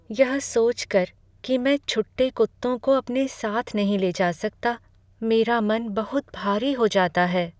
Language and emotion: Hindi, sad